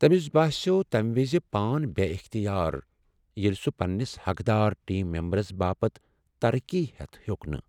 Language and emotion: Kashmiri, sad